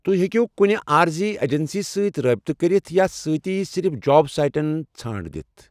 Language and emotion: Kashmiri, neutral